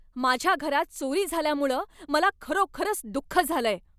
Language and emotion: Marathi, angry